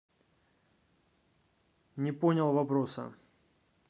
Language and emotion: Russian, neutral